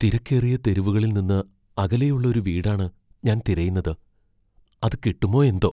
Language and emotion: Malayalam, fearful